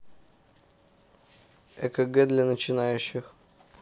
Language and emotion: Russian, neutral